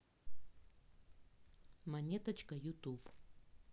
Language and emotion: Russian, neutral